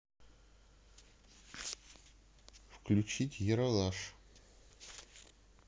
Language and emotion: Russian, neutral